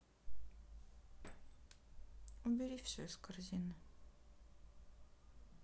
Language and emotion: Russian, sad